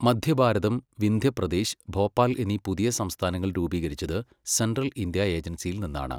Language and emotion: Malayalam, neutral